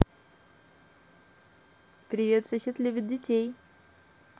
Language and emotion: Russian, positive